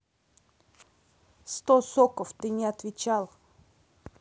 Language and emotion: Russian, angry